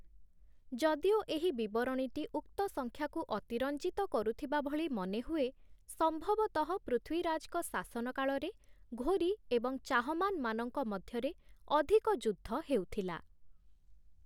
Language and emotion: Odia, neutral